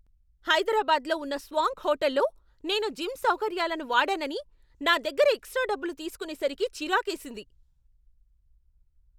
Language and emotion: Telugu, angry